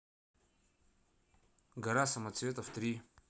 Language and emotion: Russian, neutral